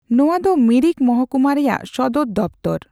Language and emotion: Santali, neutral